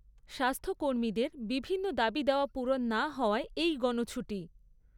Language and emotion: Bengali, neutral